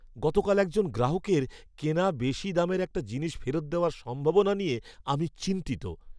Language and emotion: Bengali, fearful